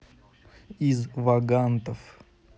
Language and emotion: Russian, neutral